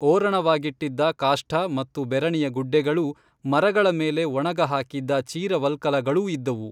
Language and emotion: Kannada, neutral